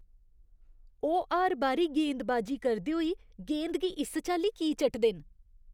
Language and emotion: Dogri, disgusted